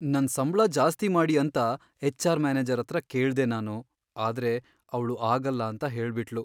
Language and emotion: Kannada, sad